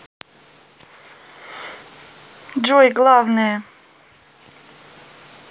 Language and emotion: Russian, neutral